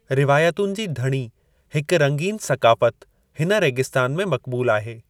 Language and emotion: Sindhi, neutral